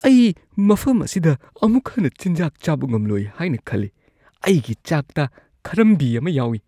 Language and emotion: Manipuri, disgusted